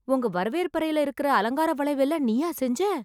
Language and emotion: Tamil, surprised